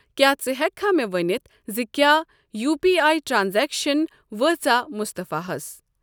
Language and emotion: Kashmiri, neutral